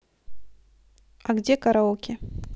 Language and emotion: Russian, neutral